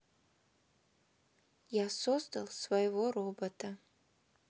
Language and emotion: Russian, neutral